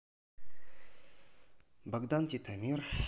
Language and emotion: Russian, neutral